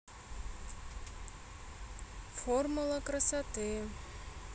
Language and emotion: Russian, neutral